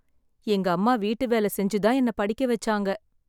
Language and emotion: Tamil, sad